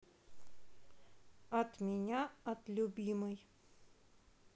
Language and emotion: Russian, neutral